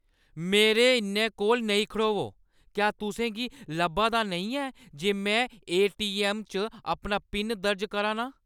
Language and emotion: Dogri, angry